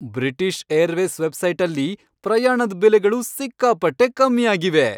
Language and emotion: Kannada, happy